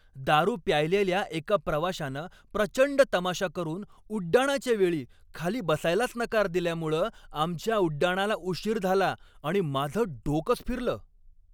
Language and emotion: Marathi, angry